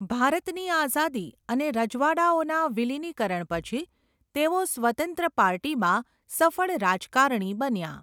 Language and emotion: Gujarati, neutral